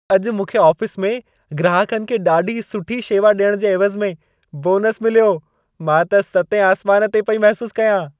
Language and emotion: Sindhi, happy